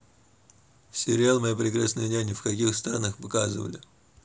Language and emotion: Russian, neutral